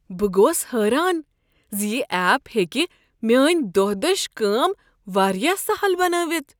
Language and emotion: Kashmiri, surprised